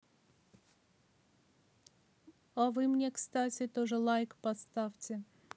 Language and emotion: Russian, neutral